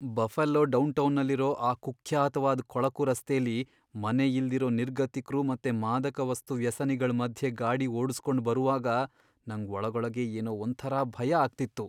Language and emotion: Kannada, fearful